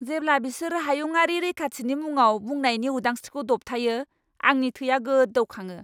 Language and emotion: Bodo, angry